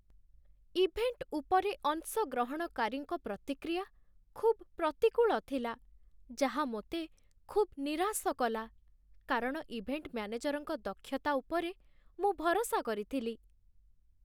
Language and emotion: Odia, sad